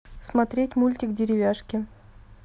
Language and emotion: Russian, neutral